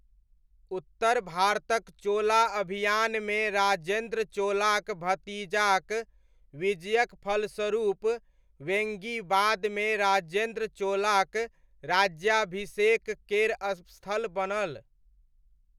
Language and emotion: Maithili, neutral